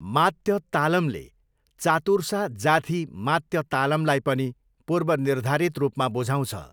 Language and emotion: Nepali, neutral